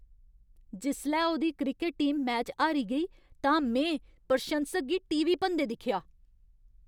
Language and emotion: Dogri, angry